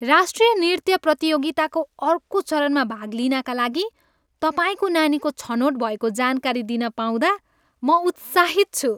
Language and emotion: Nepali, happy